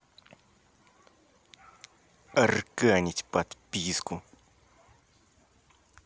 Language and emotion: Russian, angry